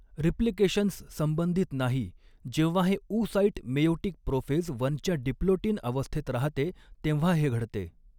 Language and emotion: Marathi, neutral